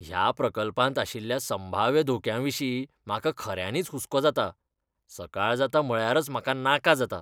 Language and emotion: Goan Konkani, disgusted